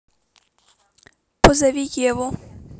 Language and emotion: Russian, neutral